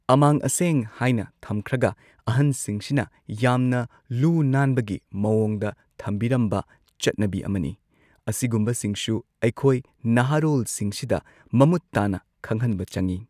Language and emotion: Manipuri, neutral